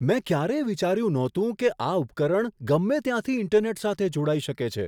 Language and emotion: Gujarati, surprised